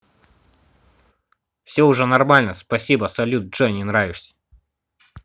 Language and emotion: Russian, angry